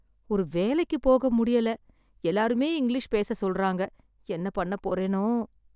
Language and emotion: Tamil, sad